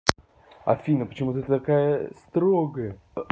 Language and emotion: Russian, angry